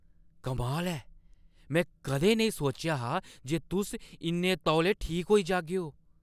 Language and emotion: Dogri, surprised